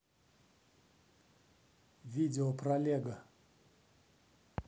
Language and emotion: Russian, neutral